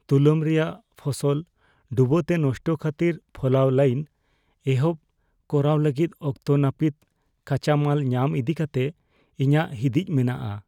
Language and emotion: Santali, fearful